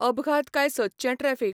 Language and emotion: Goan Konkani, neutral